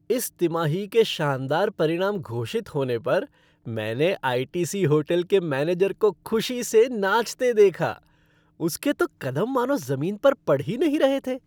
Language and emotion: Hindi, happy